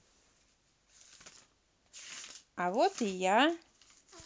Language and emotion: Russian, positive